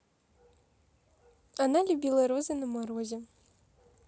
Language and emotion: Russian, neutral